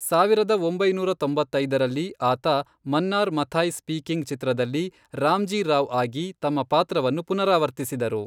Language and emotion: Kannada, neutral